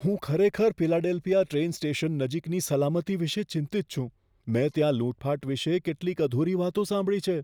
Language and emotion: Gujarati, fearful